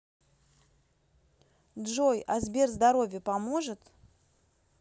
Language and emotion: Russian, neutral